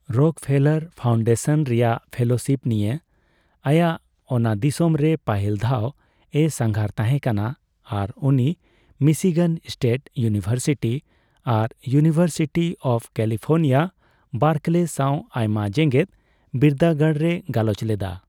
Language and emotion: Santali, neutral